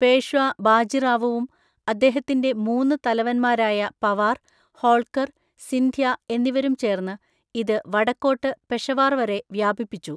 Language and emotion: Malayalam, neutral